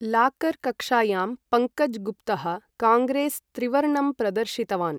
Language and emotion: Sanskrit, neutral